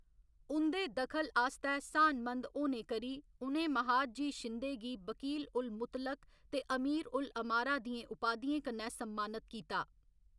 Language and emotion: Dogri, neutral